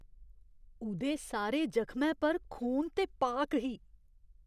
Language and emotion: Dogri, disgusted